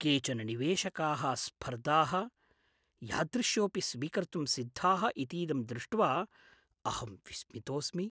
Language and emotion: Sanskrit, surprised